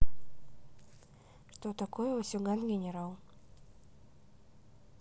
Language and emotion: Russian, neutral